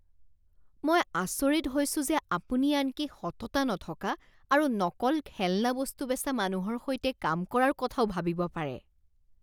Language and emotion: Assamese, disgusted